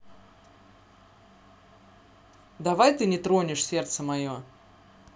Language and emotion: Russian, angry